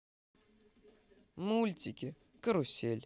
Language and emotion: Russian, positive